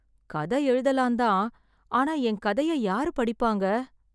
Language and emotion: Tamil, sad